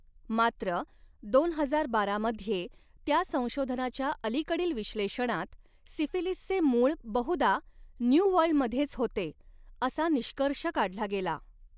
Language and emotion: Marathi, neutral